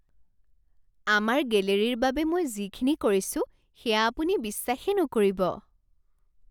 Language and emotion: Assamese, surprised